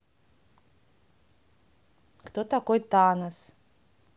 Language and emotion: Russian, neutral